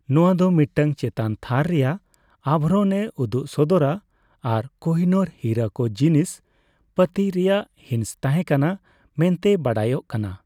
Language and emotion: Santali, neutral